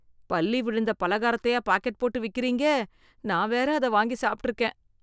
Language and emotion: Tamil, disgusted